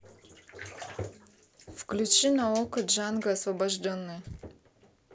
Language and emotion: Russian, neutral